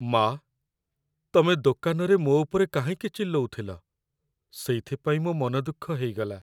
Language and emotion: Odia, sad